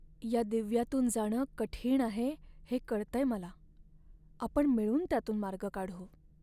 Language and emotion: Marathi, sad